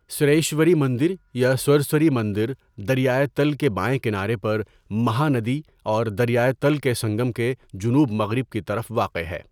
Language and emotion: Urdu, neutral